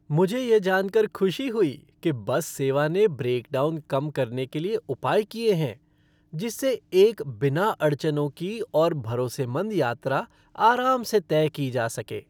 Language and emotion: Hindi, happy